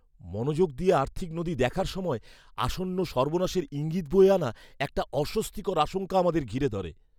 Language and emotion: Bengali, fearful